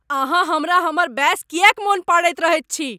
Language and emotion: Maithili, angry